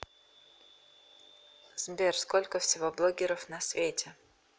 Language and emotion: Russian, neutral